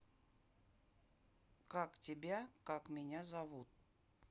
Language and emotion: Russian, neutral